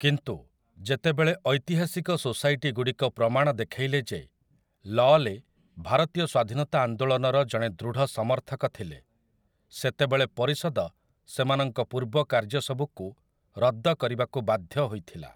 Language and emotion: Odia, neutral